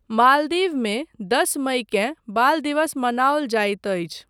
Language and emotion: Maithili, neutral